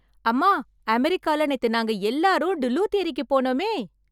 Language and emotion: Tamil, happy